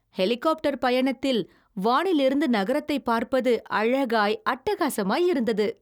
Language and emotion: Tamil, happy